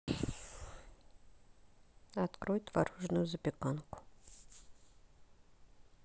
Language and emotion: Russian, neutral